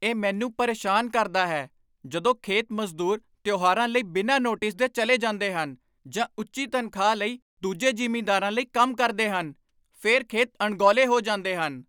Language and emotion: Punjabi, angry